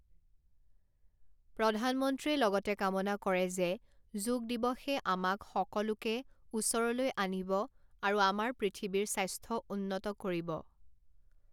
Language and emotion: Assamese, neutral